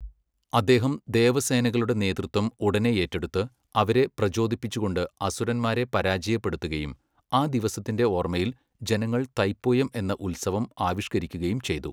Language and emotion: Malayalam, neutral